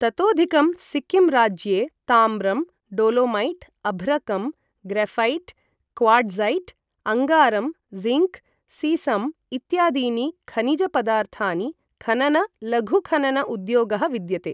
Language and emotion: Sanskrit, neutral